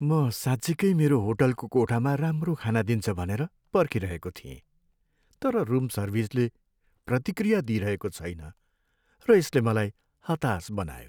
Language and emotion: Nepali, sad